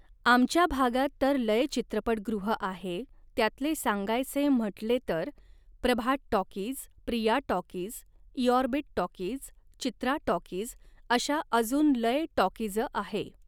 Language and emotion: Marathi, neutral